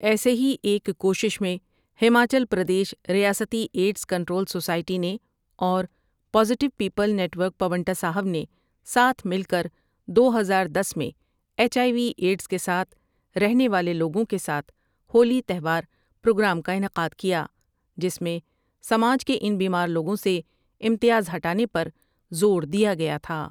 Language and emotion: Urdu, neutral